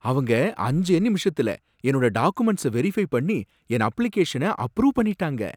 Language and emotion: Tamil, surprised